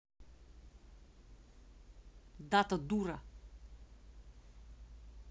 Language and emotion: Russian, angry